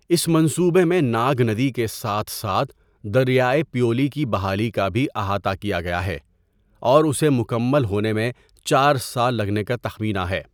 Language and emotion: Urdu, neutral